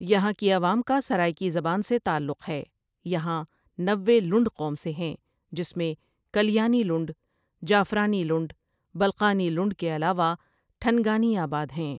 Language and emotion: Urdu, neutral